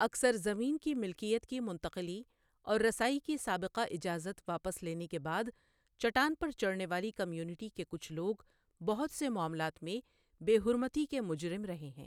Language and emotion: Urdu, neutral